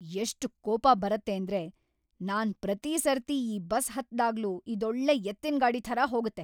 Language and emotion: Kannada, angry